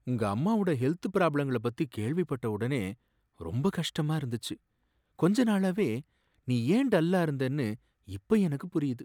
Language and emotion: Tamil, sad